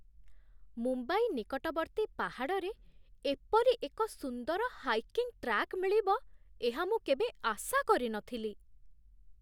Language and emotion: Odia, surprised